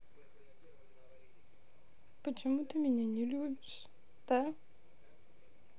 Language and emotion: Russian, sad